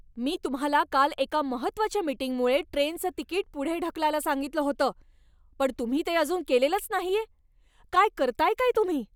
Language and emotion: Marathi, angry